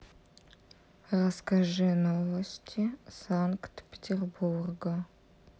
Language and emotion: Russian, neutral